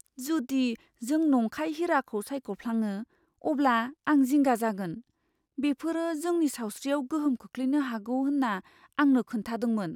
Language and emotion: Bodo, fearful